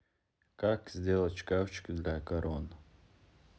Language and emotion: Russian, neutral